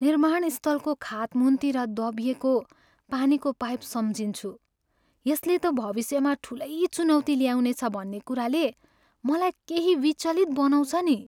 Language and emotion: Nepali, sad